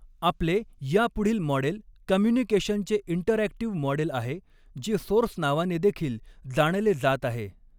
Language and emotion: Marathi, neutral